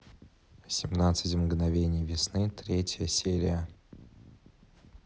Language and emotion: Russian, neutral